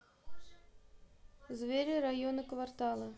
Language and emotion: Russian, neutral